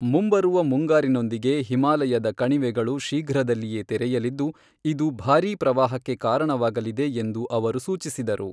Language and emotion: Kannada, neutral